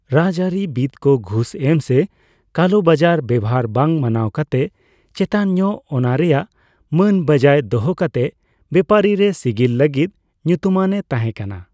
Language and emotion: Santali, neutral